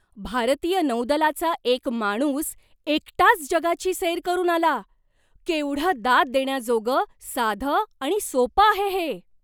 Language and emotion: Marathi, surprised